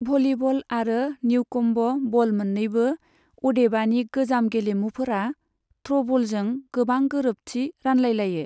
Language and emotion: Bodo, neutral